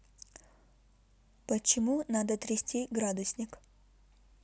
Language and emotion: Russian, neutral